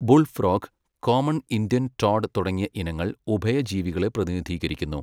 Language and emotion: Malayalam, neutral